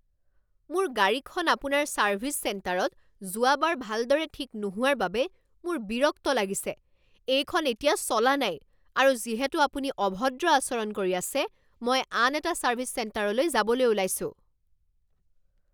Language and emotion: Assamese, angry